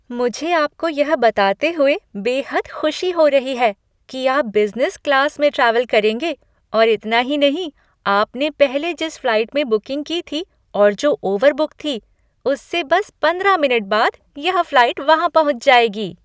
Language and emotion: Hindi, happy